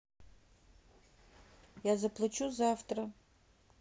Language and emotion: Russian, neutral